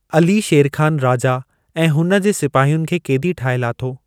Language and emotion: Sindhi, neutral